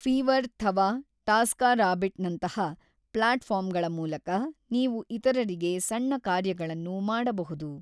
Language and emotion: Kannada, neutral